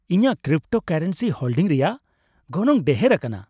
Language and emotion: Santali, happy